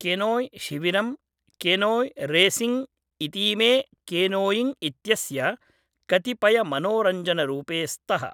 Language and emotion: Sanskrit, neutral